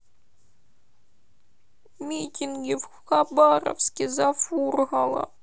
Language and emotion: Russian, sad